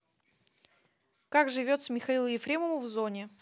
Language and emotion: Russian, neutral